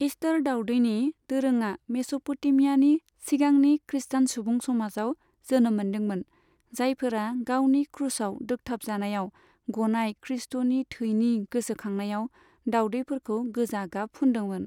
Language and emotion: Bodo, neutral